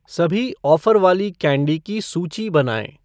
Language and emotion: Hindi, neutral